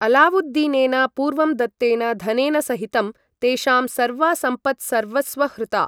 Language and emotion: Sanskrit, neutral